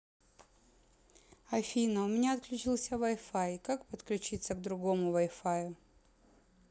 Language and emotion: Russian, neutral